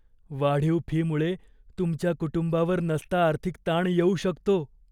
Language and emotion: Marathi, fearful